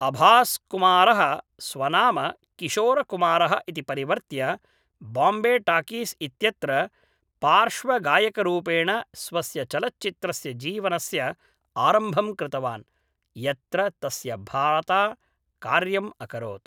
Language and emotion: Sanskrit, neutral